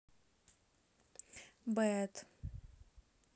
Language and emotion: Russian, neutral